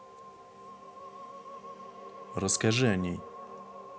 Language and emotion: Russian, neutral